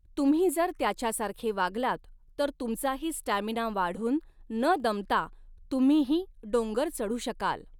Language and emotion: Marathi, neutral